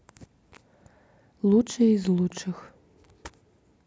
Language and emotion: Russian, neutral